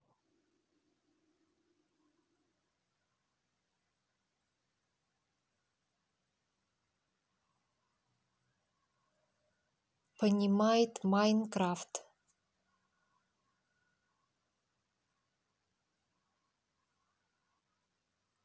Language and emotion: Russian, neutral